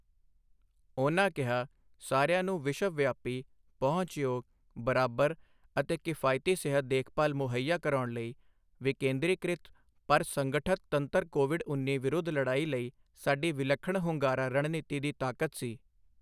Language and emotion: Punjabi, neutral